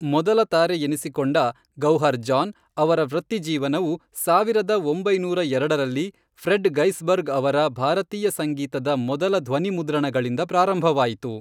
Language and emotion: Kannada, neutral